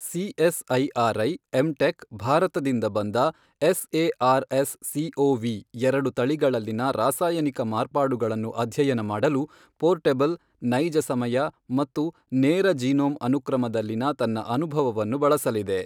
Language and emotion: Kannada, neutral